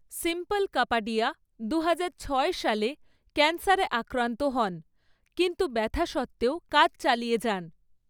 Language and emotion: Bengali, neutral